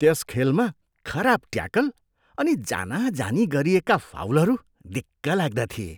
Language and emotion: Nepali, disgusted